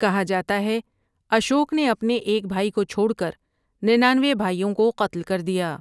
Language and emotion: Urdu, neutral